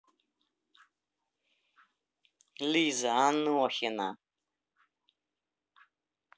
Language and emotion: Russian, angry